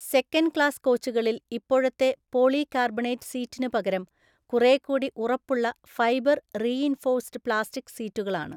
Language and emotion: Malayalam, neutral